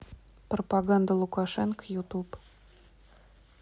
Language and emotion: Russian, neutral